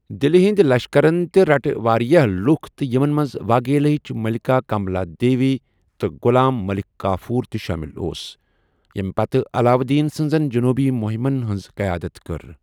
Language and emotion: Kashmiri, neutral